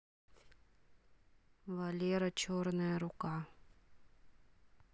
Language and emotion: Russian, neutral